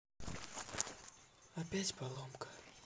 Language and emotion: Russian, sad